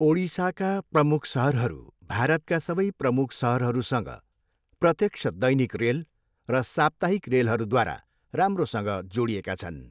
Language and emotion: Nepali, neutral